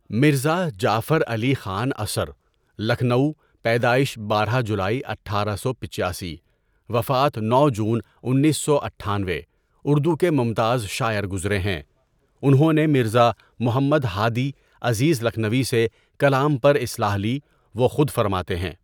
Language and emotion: Urdu, neutral